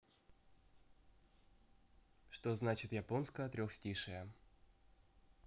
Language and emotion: Russian, neutral